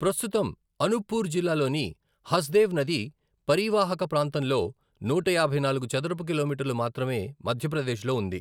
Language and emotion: Telugu, neutral